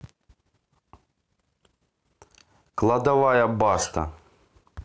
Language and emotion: Russian, neutral